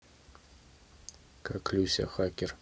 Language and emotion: Russian, neutral